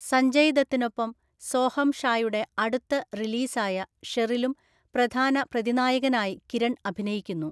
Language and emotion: Malayalam, neutral